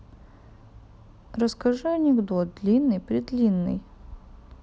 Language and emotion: Russian, neutral